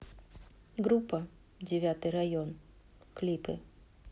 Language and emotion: Russian, neutral